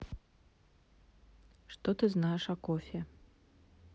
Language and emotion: Russian, neutral